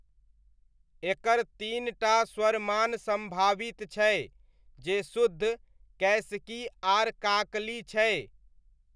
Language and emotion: Maithili, neutral